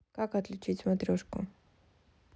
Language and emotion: Russian, neutral